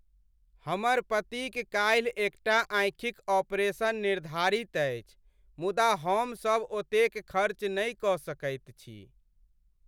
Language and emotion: Maithili, sad